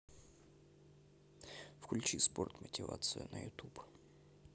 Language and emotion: Russian, neutral